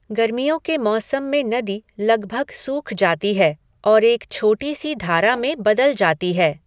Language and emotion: Hindi, neutral